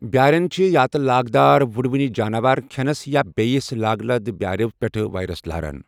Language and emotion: Kashmiri, neutral